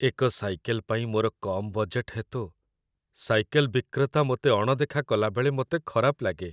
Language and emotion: Odia, sad